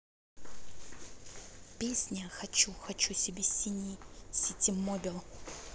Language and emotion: Russian, neutral